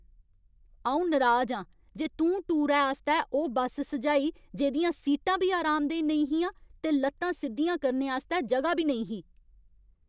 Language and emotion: Dogri, angry